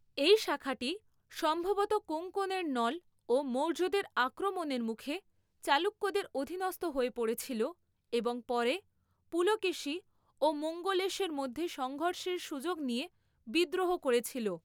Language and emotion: Bengali, neutral